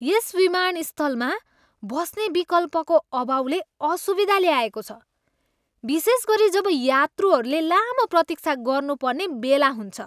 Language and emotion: Nepali, disgusted